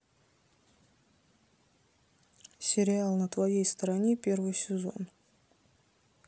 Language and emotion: Russian, neutral